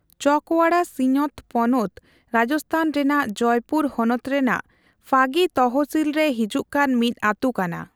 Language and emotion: Santali, neutral